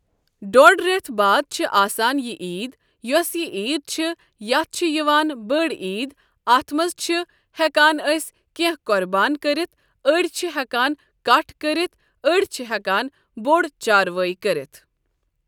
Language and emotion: Kashmiri, neutral